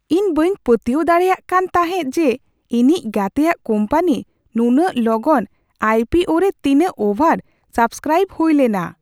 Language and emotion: Santali, surprised